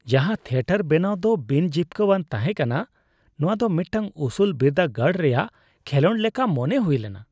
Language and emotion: Santali, disgusted